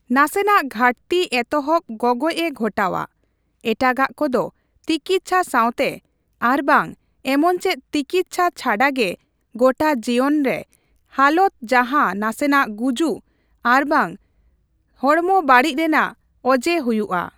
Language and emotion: Santali, neutral